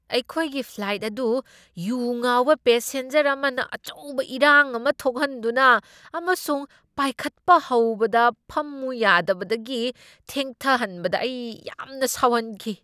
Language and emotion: Manipuri, angry